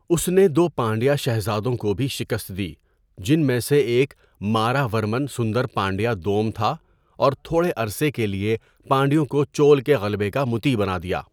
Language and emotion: Urdu, neutral